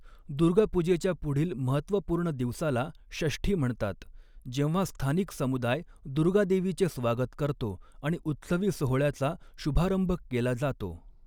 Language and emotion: Marathi, neutral